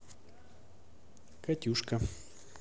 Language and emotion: Russian, neutral